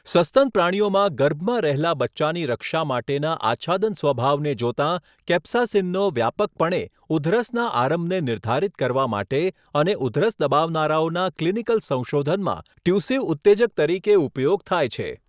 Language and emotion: Gujarati, neutral